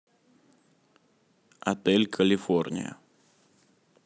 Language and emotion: Russian, neutral